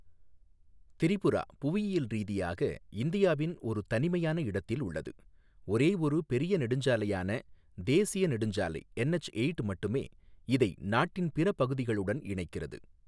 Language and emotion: Tamil, neutral